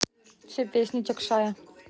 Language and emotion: Russian, neutral